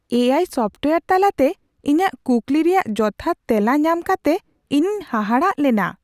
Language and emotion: Santali, surprised